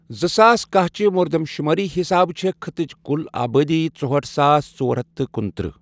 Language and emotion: Kashmiri, neutral